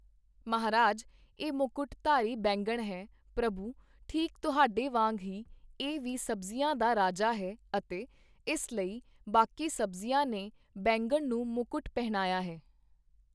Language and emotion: Punjabi, neutral